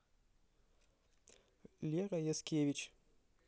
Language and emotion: Russian, neutral